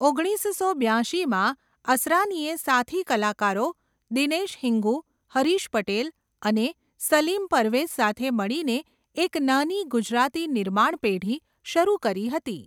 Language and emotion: Gujarati, neutral